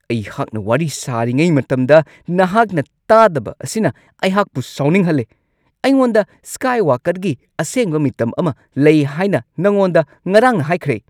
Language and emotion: Manipuri, angry